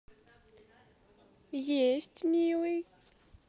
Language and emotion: Russian, positive